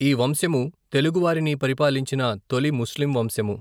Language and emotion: Telugu, neutral